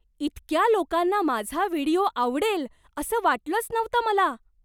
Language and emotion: Marathi, surprised